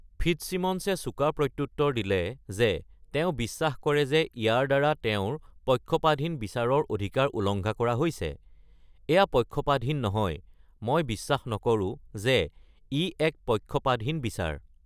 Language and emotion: Assamese, neutral